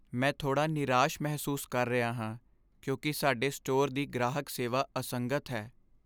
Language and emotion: Punjabi, sad